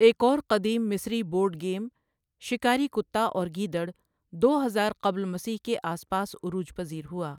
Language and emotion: Urdu, neutral